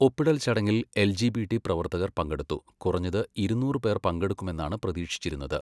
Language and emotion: Malayalam, neutral